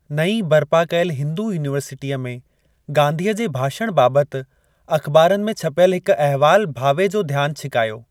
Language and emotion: Sindhi, neutral